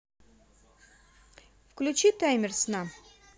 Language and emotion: Russian, positive